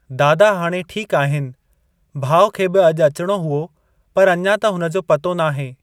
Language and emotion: Sindhi, neutral